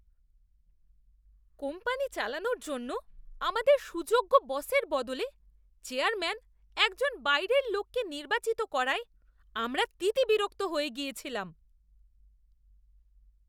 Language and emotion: Bengali, disgusted